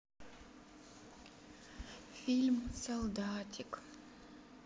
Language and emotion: Russian, sad